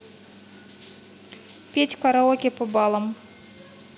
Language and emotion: Russian, neutral